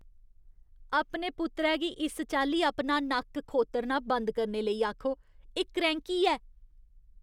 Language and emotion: Dogri, disgusted